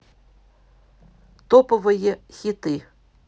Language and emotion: Russian, neutral